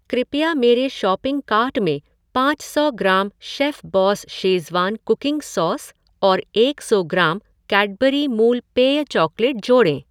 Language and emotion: Hindi, neutral